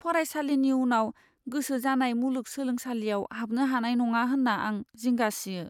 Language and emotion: Bodo, fearful